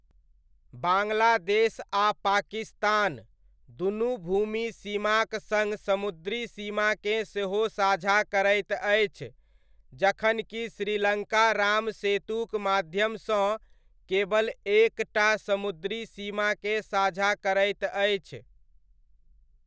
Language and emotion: Maithili, neutral